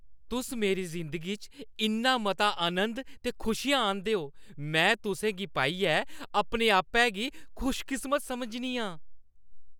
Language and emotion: Dogri, happy